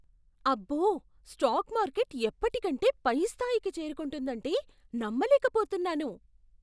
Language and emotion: Telugu, surprised